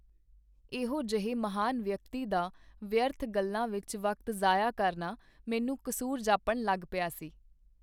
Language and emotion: Punjabi, neutral